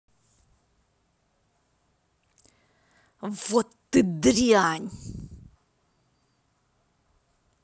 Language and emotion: Russian, angry